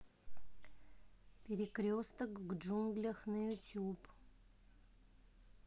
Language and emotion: Russian, neutral